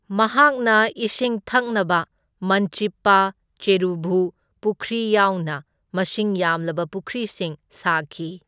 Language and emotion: Manipuri, neutral